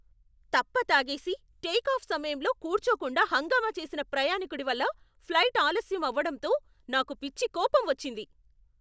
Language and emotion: Telugu, angry